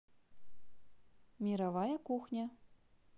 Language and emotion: Russian, positive